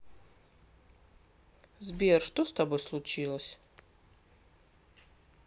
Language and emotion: Russian, sad